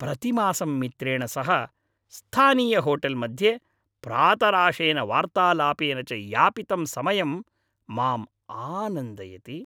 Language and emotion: Sanskrit, happy